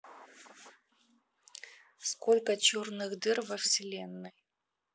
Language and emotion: Russian, neutral